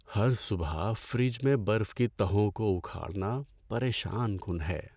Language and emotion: Urdu, sad